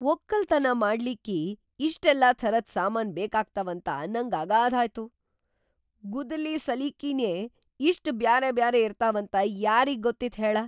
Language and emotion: Kannada, surprised